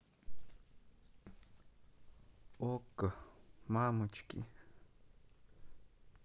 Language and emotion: Russian, sad